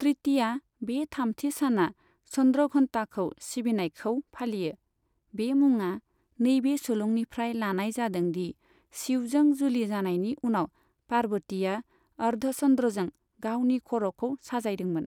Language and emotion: Bodo, neutral